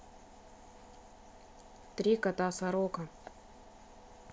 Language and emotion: Russian, neutral